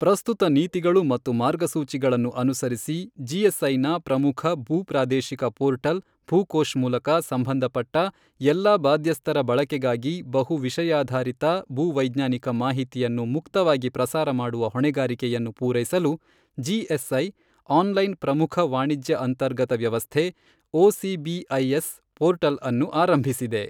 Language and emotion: Kannada, neutral